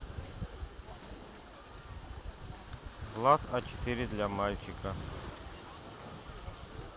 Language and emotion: Russian, neutral